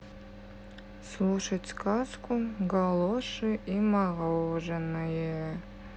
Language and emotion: Russian, sad